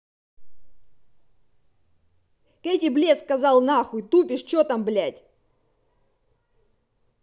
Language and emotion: Russian, angry